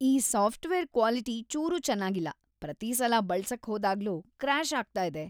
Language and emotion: Kannada, disgusted